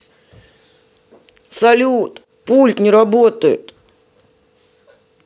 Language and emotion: Russian, sad